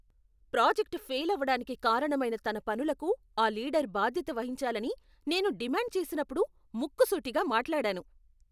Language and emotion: Telugu, angry